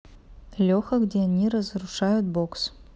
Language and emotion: Russian, neutral